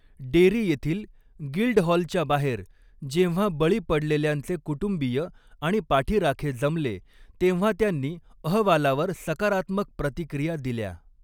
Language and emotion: Marathi, neutral